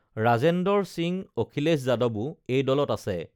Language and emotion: Assamese, neutral